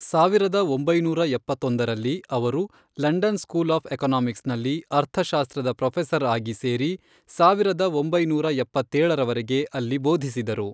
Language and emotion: Kannada, neutral